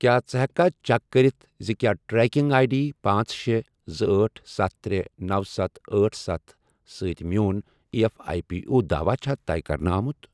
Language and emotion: Kashmiri, neutral